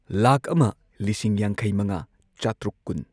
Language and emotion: Manipuri, neutral